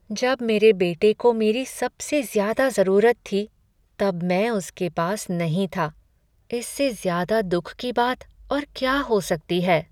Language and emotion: Hindi, sad